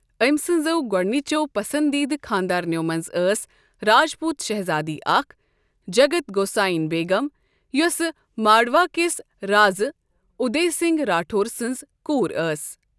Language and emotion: Kashmiri, neutral